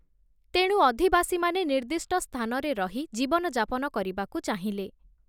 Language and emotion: Odia, neutral